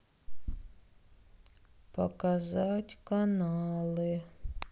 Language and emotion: Russian, sad